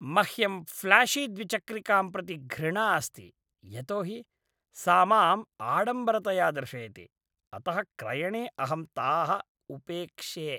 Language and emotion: Sanskrit, disgusted